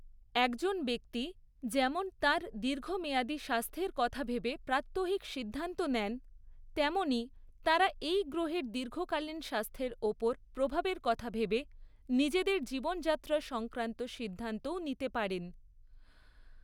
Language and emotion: Bengali, neutral